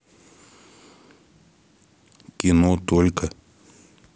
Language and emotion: Russian, neutral